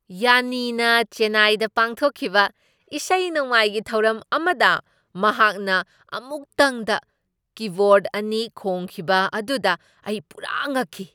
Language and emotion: Manipuri, surprised